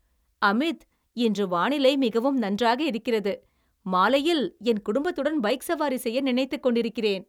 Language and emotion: Tamil, happy